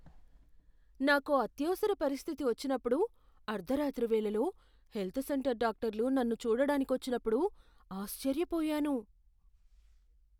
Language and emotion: Telugu, surprised